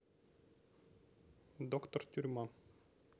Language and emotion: Russian, neutral